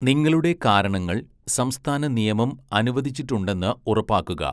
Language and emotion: Malayalam, neutral